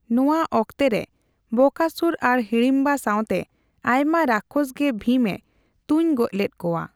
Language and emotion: Santali, neutral